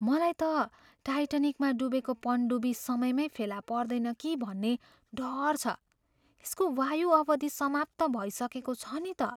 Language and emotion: Nepali, fearful